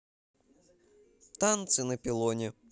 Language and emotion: Russian, positive